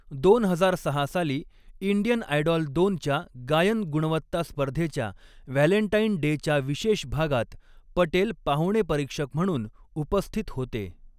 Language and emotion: Marathi, neutral